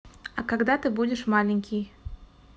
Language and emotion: Russian, neutral